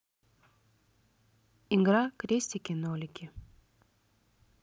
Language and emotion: Russian, neutral